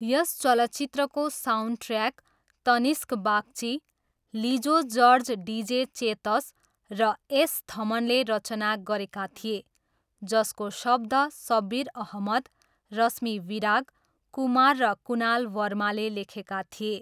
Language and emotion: Nepali, neutral